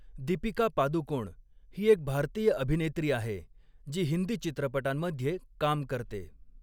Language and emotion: Marathi, neutral